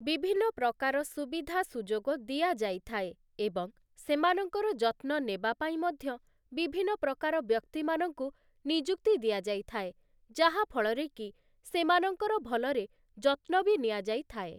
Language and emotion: Odia, neutral